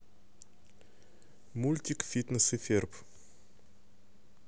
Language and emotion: Russian, neutral